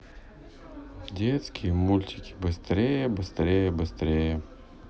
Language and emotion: Russian, sad